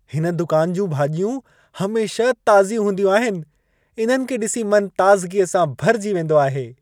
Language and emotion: Sindhi, happy